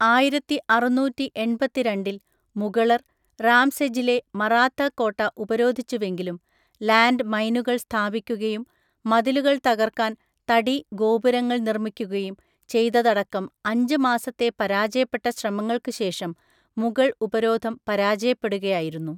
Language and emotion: Malayalam, neutral